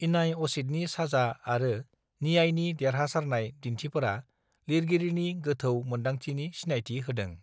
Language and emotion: Bodo, neutral